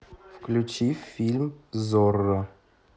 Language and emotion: Russian, neutral